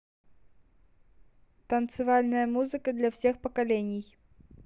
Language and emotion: Russian, neutral